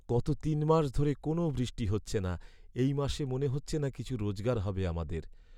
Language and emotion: Bengali, sad